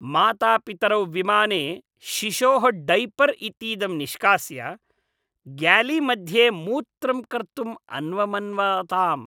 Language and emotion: Sanskrit, disgusted